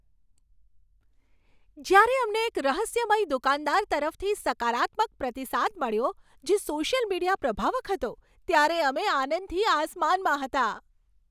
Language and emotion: Gujarati, happy